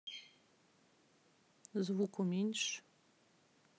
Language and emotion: Russian, neutral